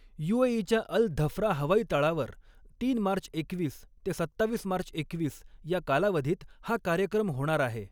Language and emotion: Marathi, neutral